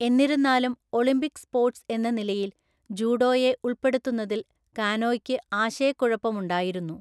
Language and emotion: Malayalam, neutral